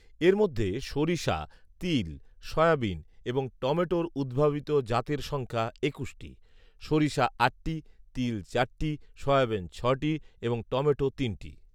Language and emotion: Bengali, neutral